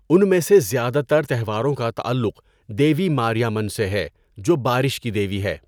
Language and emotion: Urdu, neutral